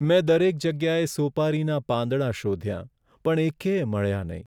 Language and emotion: Gujarati, sad